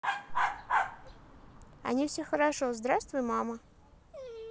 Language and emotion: Russian, positive